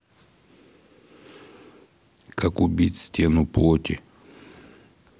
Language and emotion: Russian, neutral